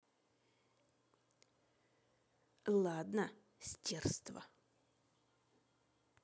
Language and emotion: Russian, angry